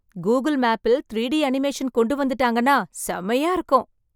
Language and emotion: Tamil, happy